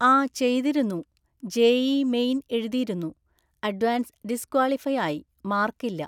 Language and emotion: Malayalam, neutral